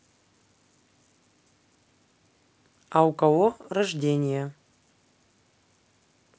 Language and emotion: Russian, neutral